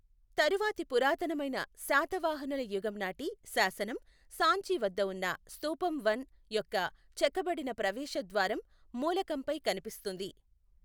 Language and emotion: Telugu, neutral